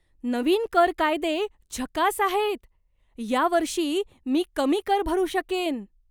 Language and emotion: Marathi, surprised